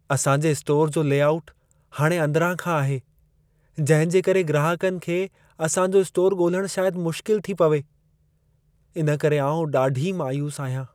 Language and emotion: Sindhi, sad